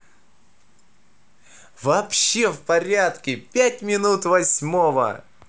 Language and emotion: Russian, positive